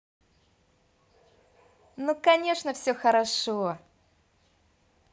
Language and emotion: Russian, positive